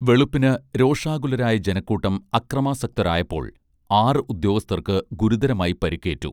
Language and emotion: Malayalam, neutral